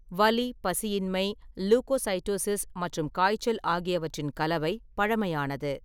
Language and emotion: Tamil, neutral